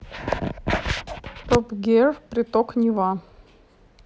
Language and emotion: Russian, neutral